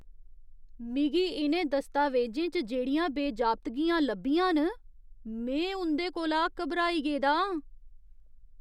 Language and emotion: Dogri, disgusted